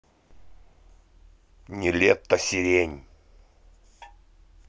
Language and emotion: Russian, angry